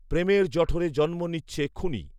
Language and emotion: Bengali, neutral